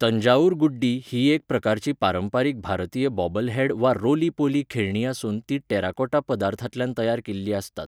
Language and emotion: Goan Konkani, neutral